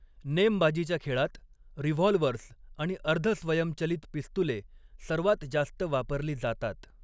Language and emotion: Marathi, neutral